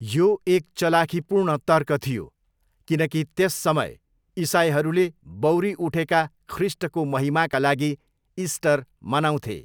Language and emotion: Nepali, neutral